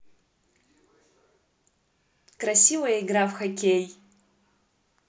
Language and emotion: Russian, positive